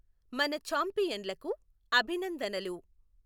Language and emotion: Telugu, neutral